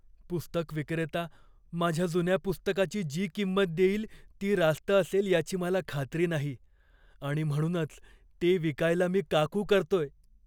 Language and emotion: Marathi, fearful